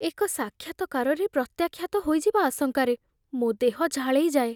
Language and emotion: Odia, fearful